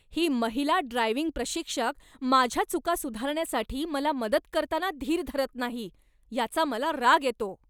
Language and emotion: Marathi, angry